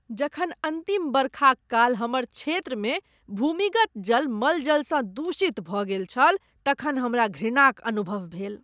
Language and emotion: Maithili, disgusted